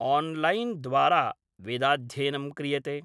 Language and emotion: Sanskrit, neutral